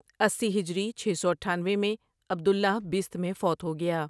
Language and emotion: Urdu, neutral